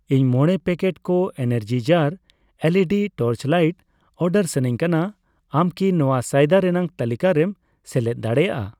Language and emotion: Santali, neutral